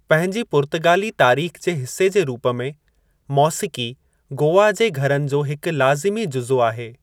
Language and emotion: Sindhi, neutral